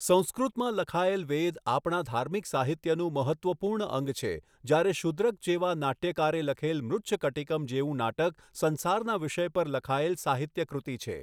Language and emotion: Gujarati, neutral